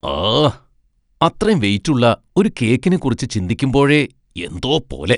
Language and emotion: Malayalam, disgusted